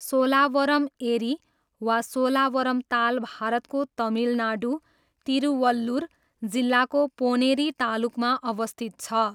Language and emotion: Nepali, neutral